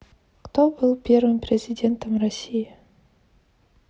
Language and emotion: Russian, neutral